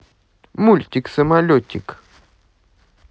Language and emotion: Russian, positive